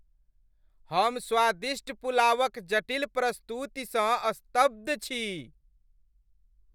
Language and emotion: Maithili, happy